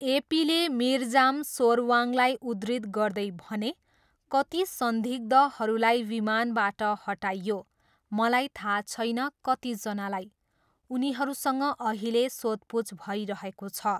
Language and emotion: Nepali, neutral